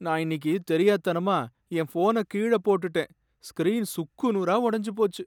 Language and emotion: Tamil, sad